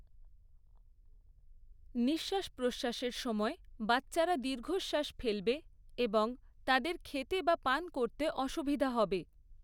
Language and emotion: Bengali, neutral